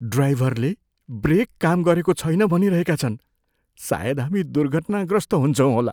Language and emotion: Nepali, fearful